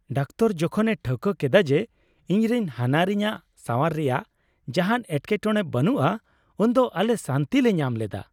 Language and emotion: Santali, happy